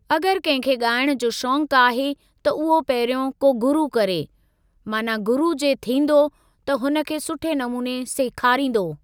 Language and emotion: Sindhi, neutral